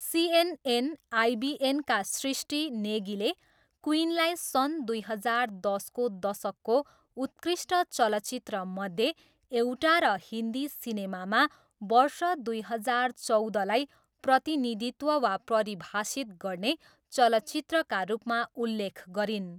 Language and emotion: Nepali, neutral